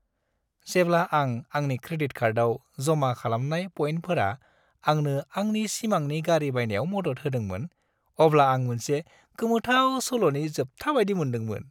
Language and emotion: Bodo, happy